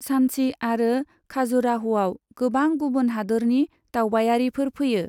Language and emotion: Bodo, neutral